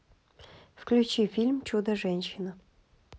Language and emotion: Russian, neutral